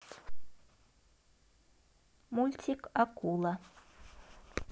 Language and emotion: Russian, neutral